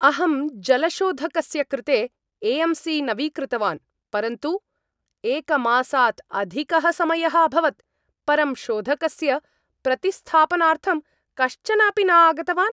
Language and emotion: Sanskrit, angry